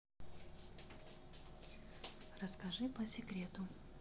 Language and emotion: Russian, neutral